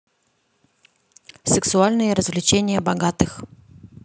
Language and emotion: Russian, neutral